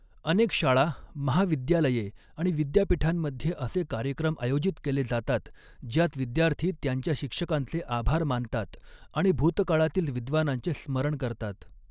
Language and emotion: Marathi, neutral